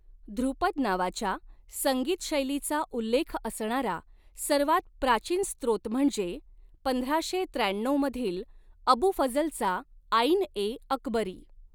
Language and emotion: Marathi, neutral